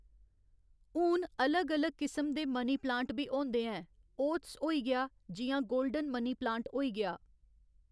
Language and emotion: Dogri, neutral